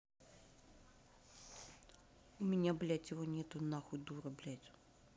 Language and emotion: Russian, angry